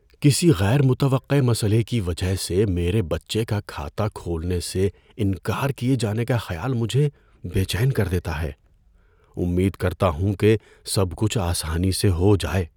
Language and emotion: Urdu, fearful